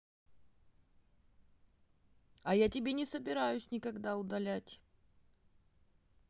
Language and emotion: Russian, neutral